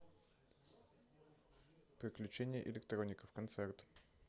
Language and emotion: Russian, neutral